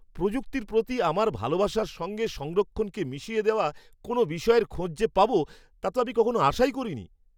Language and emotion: Bengali, surprised